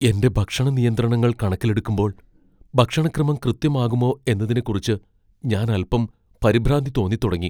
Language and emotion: Malayalam, fearful